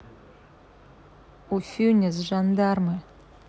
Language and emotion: Russian, neutral